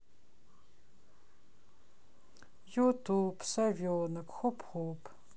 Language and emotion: Russian, sad